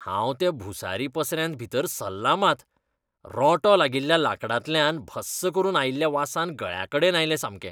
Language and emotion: Goan Konkani, disgusted